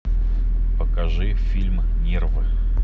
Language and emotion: Russian, neutral